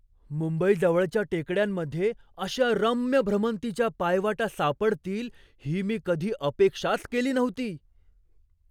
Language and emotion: Marathi, surprised